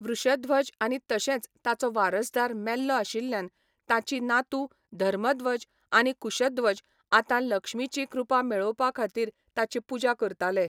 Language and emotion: Goan Konkani, neutral